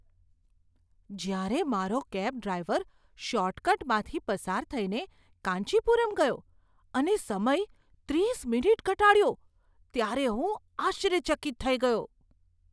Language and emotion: Gujarati, surprised